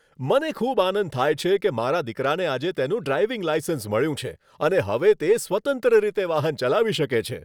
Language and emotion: Gujarati, happy